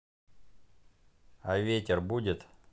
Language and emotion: Russian, neutral